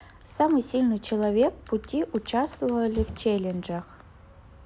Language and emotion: Russian, neutral